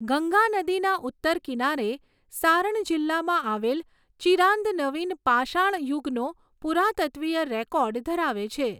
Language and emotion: Gujarati, neutral